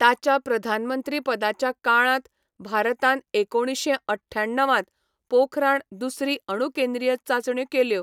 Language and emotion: Goan Konkani, neutral